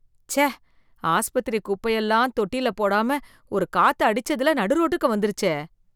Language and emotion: Tamil, disgusted